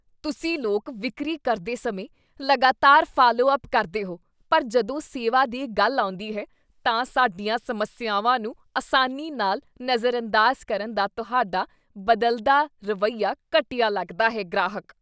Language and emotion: Punjabi, disgusted